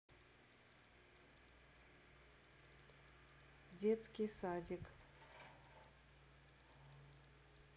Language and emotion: Russian, neutral